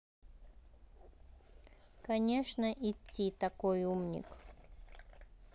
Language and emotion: Russian, neutral